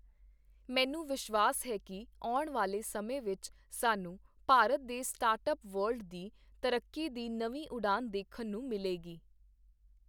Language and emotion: Punjabi, neutral